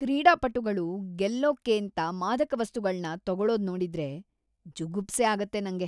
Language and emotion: Kannada, disgusted